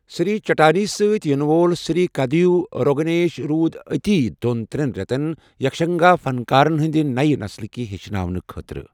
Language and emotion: Kashmiri, neutral